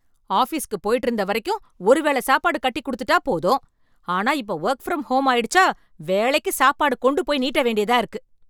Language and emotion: Tamil, angry